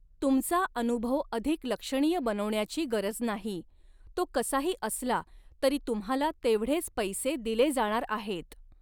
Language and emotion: Marathi, neutral